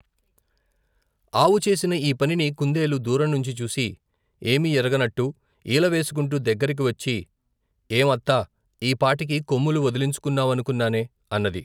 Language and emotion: Telugu, neutral